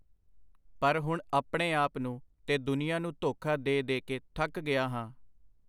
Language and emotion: Punjabi, neutral